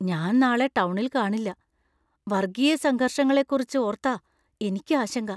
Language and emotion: Malayalam, fearful